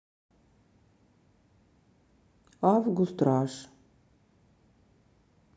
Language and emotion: Russian, neutral